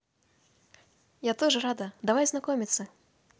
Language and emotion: Russian, positive